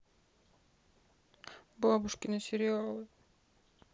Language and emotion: Russian, sad